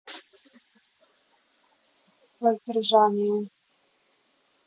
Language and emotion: Russian, neutral